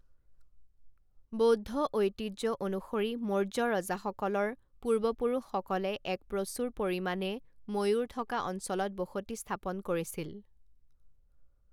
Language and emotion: Assamese, neutral